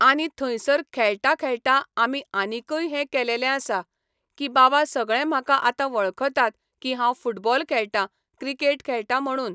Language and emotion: Goan Konkani, neutral